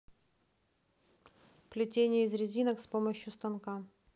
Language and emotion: Russian, neutral